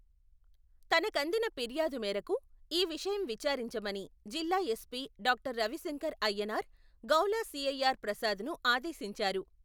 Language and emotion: Telugu, neutral